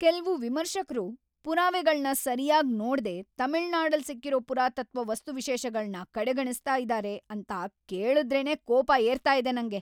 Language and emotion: Kannada, angry